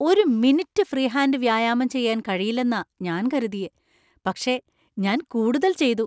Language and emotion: Malayalam, surprised